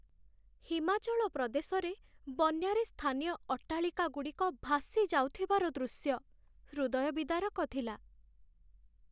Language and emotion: Odia, sad